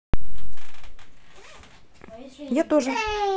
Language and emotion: Russian, neutral